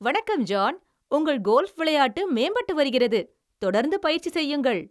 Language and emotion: Tamil, happy